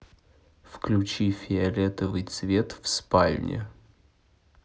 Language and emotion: Russian, neutral